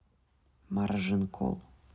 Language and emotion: Russian, neutral